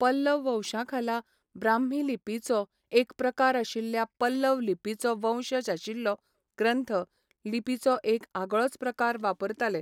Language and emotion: Goan Konkani, neutral